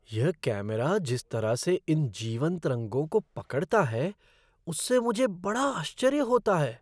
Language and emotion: Hindi, surprised